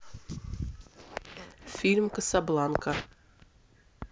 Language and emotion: Russian, neutral